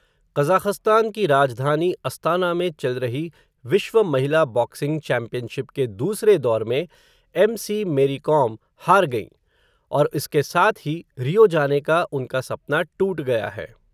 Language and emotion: Hindi, neutral